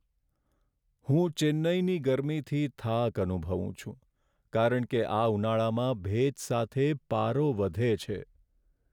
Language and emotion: Gujarati, sad